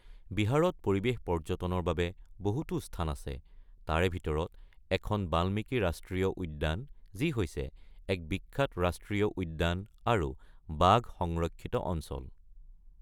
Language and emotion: Assamese, neutral